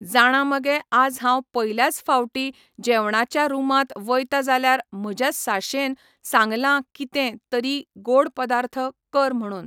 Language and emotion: Goan Konkani, neutral